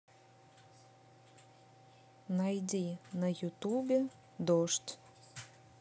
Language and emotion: Russian, neutral